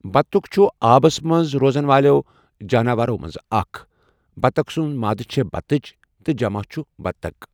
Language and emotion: Kashmiri, neutral